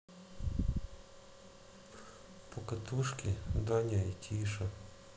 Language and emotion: Russian, sad